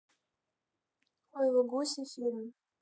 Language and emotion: Russian, neutral